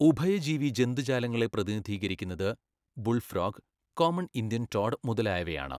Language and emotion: Malayalam, neutral